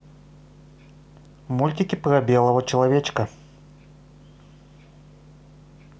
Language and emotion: Russian, positive